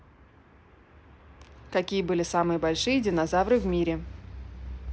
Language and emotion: Russian, neutral